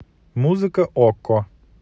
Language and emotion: Russian, neutral